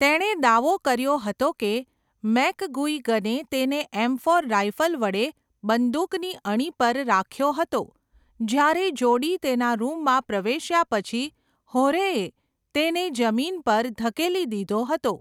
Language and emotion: Gujarati, neutral